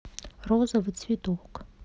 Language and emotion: Russian, neutral